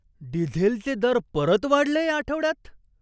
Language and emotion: Marathi, surprised